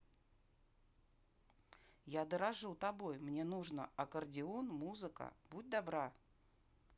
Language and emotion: Russian, neutral